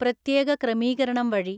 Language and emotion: Malayalam, neutral